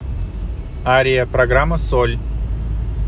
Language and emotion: Russian, neutral